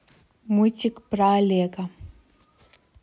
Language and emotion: Russian, neutral